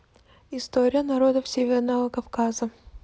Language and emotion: Russian, neutral